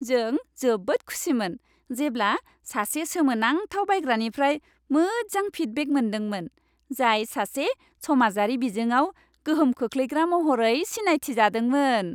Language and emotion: Bodo, happy